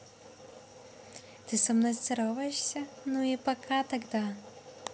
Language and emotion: Russian, neutral